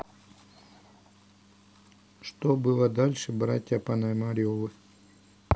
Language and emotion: Russian, neutral